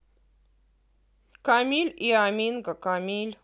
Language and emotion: Russian, neutral